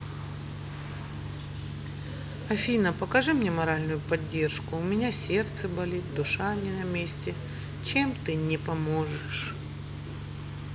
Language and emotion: Russian, sad